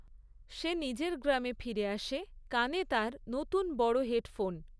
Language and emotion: Bengali, neutral